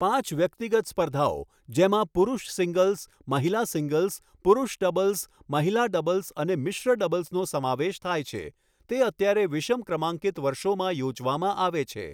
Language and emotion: Gujarati, neutral